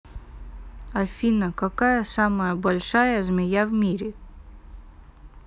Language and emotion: Russian, neutral